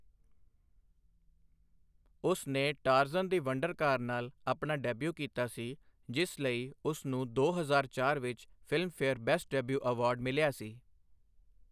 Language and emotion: Punjabi, neutral